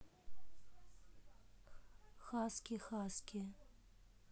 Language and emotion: Russian, neutral